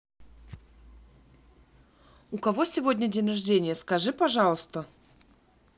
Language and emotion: Russian, neutral